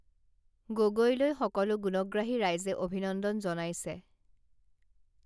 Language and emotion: Assamese, neutral